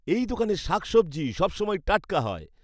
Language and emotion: Bengali, happy